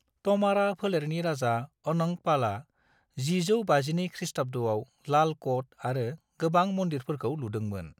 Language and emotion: Bodo, neutral